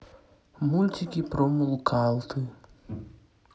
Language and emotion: Russian, sad